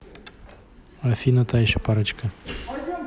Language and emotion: Russian, neutral